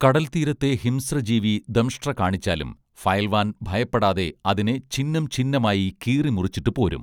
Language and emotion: Malayalam, neutral